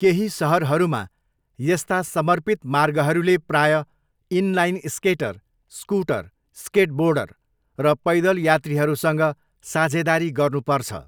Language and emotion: Nepali, neutral